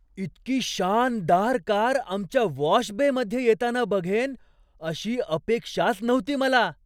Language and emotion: Marathi, surprised